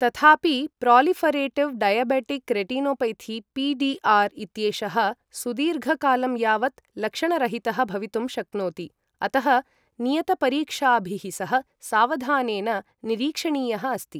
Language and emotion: Sanskrit, neutral